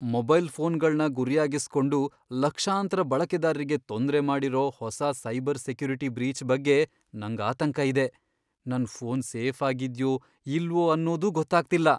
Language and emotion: Kannada, fearful